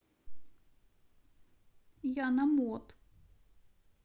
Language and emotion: Russian, neutral